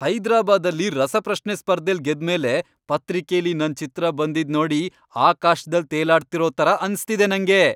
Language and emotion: Kannada, happy